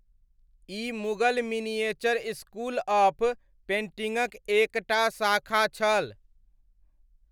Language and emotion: Maithili, neutral